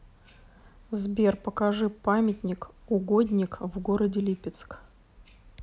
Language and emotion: Russian, neutral